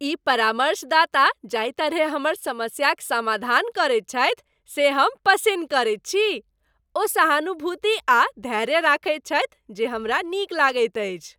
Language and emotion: Maithili, happy